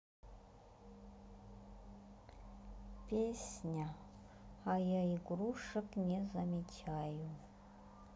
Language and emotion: Russian, sad